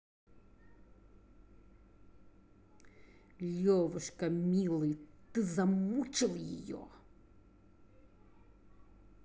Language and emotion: Russian, angry